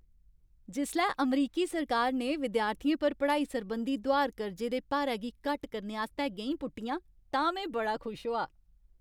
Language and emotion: Dogri, happy